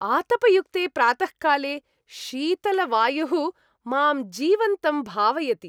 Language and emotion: Sanskrit, happy